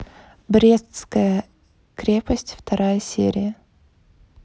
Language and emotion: Russian, neutral